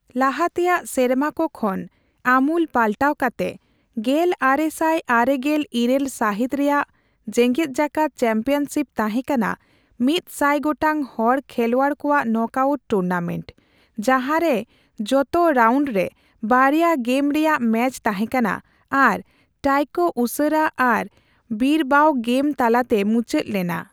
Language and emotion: Santali, neutral